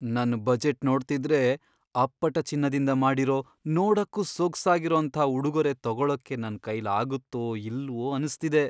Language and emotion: Kannada, fearful